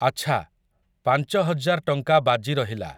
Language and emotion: Odia, neutral